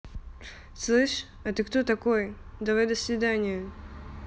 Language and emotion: Russian, angry